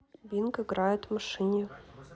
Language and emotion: Russian, neutral